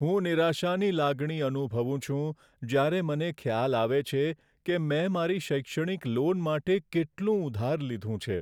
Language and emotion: Gujarati, sad